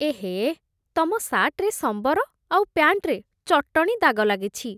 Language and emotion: Odia, disgusted